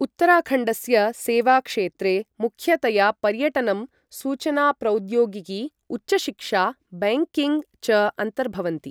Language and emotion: Sanskrit, neutral